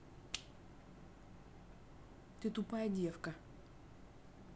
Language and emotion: Russian, angry